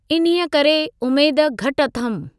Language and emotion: Sindhi, neutral